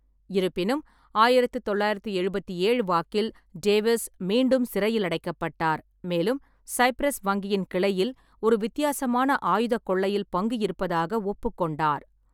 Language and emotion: Tamil, neutral